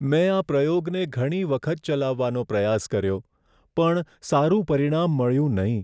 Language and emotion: Gujarati, sad